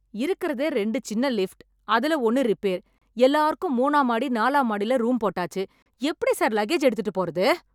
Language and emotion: Tamil, angry